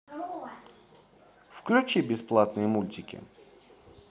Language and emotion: Russian, positive